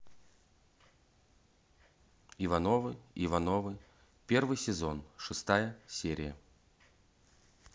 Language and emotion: Russian, neutral